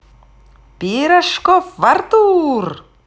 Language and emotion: Russian, positive